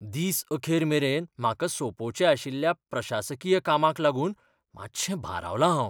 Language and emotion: Goan Konkani, fearful